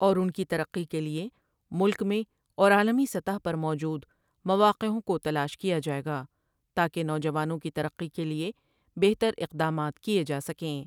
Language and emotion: Urdu, neutral